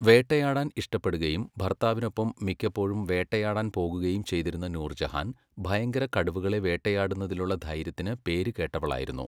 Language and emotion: Malayalam, neutral